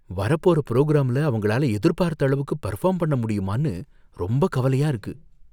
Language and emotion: Tamil, fearful